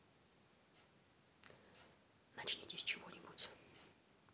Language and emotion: Russian, neutral